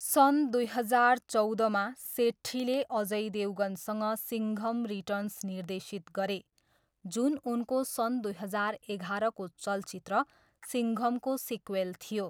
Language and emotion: Nepali, neutral